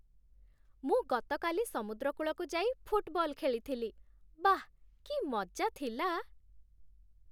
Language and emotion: Odia, happy